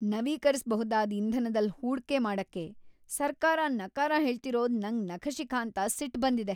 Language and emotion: Kannada, angry